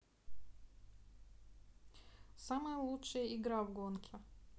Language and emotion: Russian, neutral